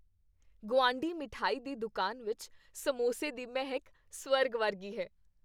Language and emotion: Punjabi, happy